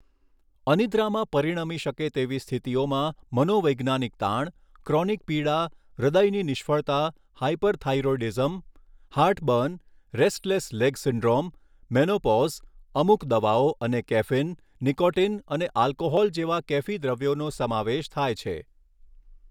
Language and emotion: Gujarati, neutral